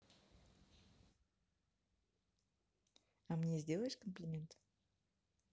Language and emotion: Russian, positive